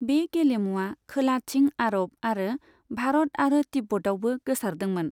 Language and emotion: Bodo, neutral